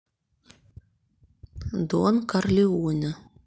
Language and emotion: Russian, neutral